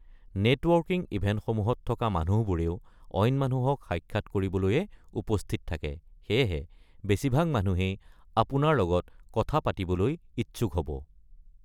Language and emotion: Assamese, neutral